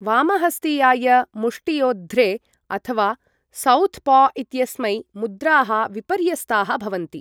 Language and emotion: Sanskrit, neutral